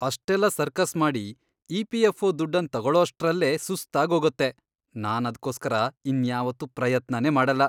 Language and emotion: Kannada, disgusted